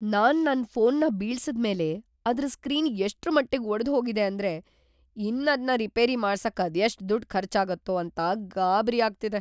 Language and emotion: Kannada, fearful